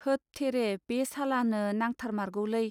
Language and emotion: Bodo, neutral